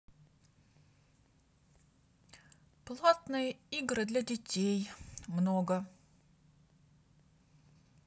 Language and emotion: Russian, neutral